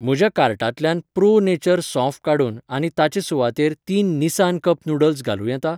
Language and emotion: Goan Konkani, neutral